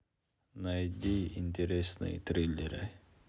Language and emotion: Russian, neutral